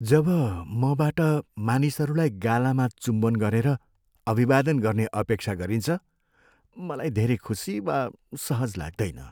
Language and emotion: Nepali, sad